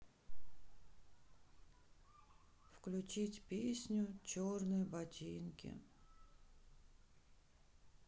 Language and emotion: Russian, sad